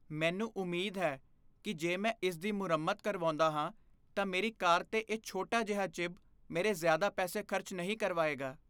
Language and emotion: Punjabi, fearful